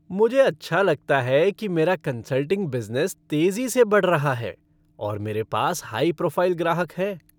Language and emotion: Hindi, happy